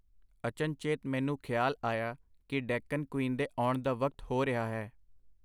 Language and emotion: Punjabi, neutral